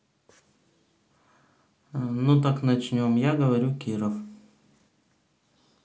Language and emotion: Russian, neutral